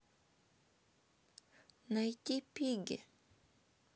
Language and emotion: Russian, sad